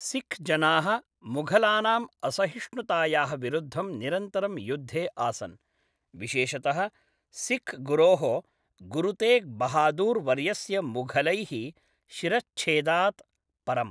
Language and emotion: Sanskrit, neutral